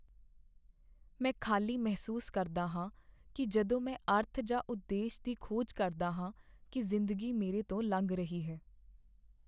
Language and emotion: Punjabi, sad